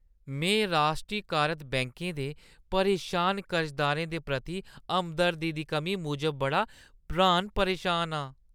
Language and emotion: Dogri, disgusted